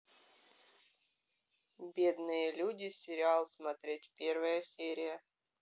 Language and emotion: Russian, neutral